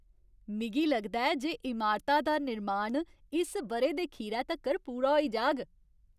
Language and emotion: Dogri, happy